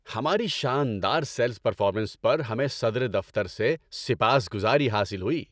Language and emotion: Urdu, happy